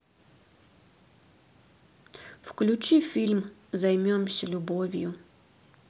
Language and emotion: Russian, neutral